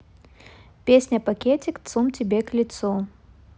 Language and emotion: Russian, neutral